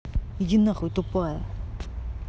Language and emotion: Russian, angry